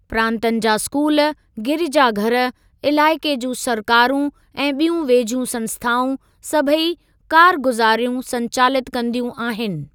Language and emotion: Sindhi, neutral